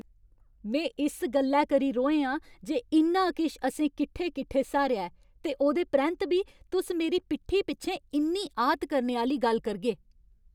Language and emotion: Dogri, angry